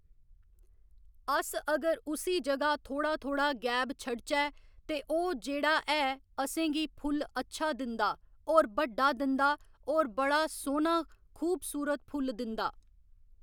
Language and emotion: Dogri, neutral